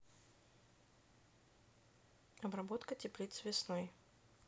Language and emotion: Russian, neutral